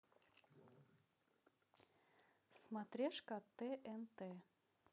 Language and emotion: Russian, neutral